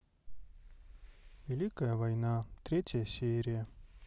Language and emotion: Russian, sad